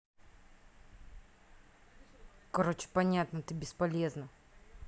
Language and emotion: Russian, angry